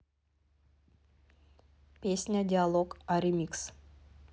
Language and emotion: Russian, neutral